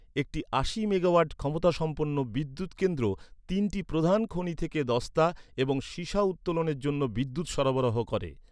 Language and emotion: Bengali, neutral